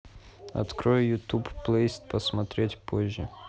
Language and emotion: Russian, neutral